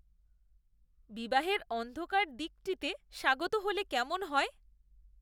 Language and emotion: Bengali, disgusted